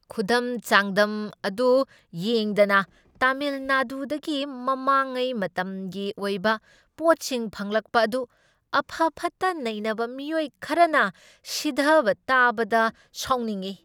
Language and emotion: Manipuri, angry